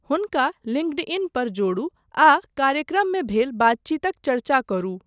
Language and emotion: Maithili, neutral